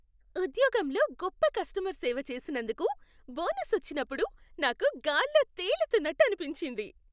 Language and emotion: Telugu, happy